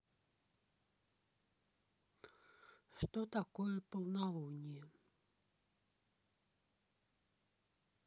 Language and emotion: Russian, neutral